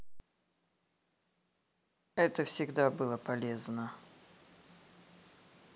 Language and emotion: Russian, neutral